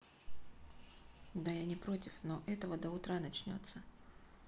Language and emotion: Russian, neutral